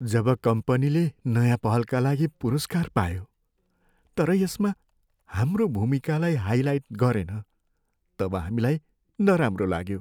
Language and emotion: Nepali, sad